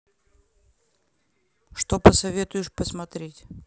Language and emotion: Russian, neutral